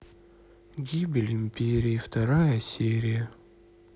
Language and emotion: Russian, sad